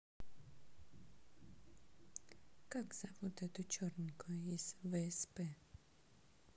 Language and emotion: Russian, neutral